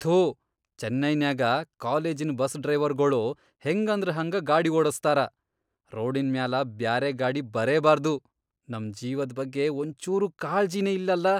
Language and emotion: Kannada, disgusted